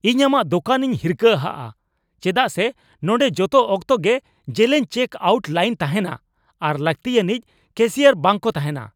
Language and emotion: Santali, angry